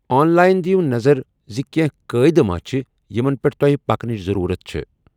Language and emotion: Kashmiri, neutral